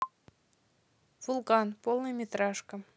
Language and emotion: Russian, neutral